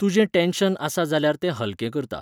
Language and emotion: Goan Konkani, neutral